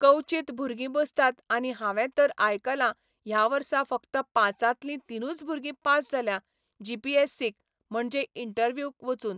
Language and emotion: Goan Konkani, neutral